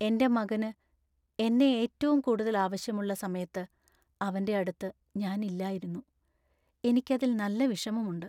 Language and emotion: Malayalam, sad